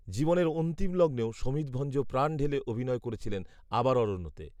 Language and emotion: Bengali, neutral